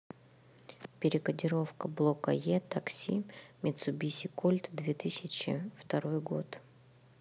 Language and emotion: Russian, neutral